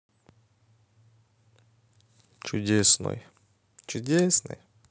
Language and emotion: Russian, positive